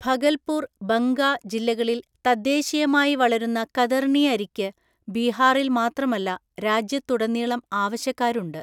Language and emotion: Malayalam, neutral